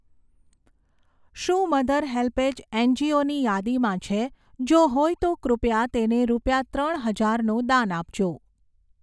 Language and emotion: Gujarati, neutral